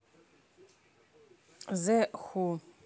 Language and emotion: Russian, neutral